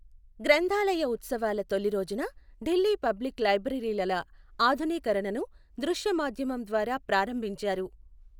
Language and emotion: Telugu, neutral